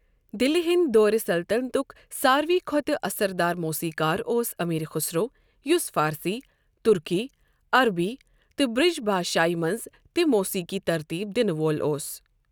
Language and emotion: Kashmiri, neutral